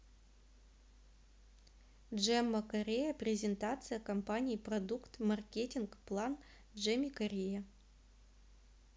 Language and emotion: Russian, neutral